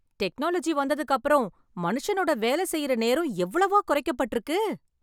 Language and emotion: Tamil, happy